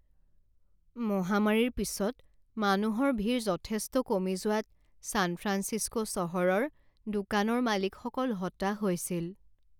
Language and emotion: Assamese, sad